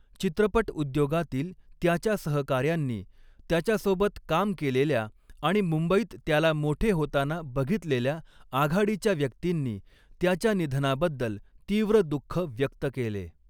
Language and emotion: Marathi, neutral